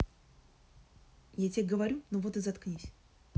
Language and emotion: Russian, angry